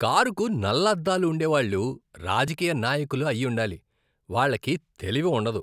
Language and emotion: Telugu, disgusted